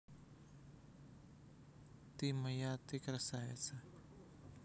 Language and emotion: Russian, neutral